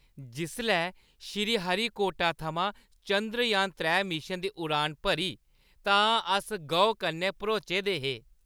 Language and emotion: Dogri, happy